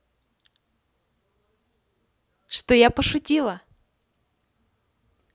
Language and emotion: Russian, positive